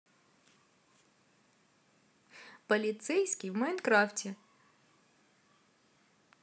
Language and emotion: Russian, positive